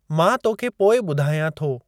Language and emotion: Sindhi, neutral